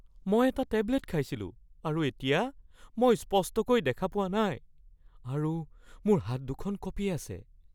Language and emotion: Assamese, fearful